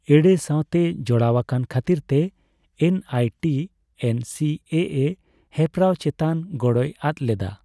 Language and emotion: Santali, neutral